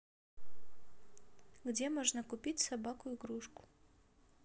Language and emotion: Russian, neutral